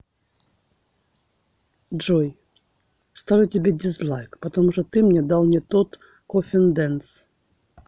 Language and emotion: Russian, neutral